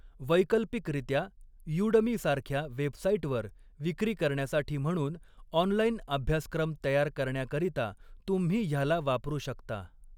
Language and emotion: Marathi, neutral